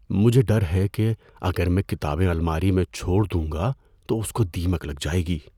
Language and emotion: Urdu, fearful